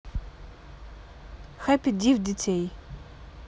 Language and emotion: Russian, neutral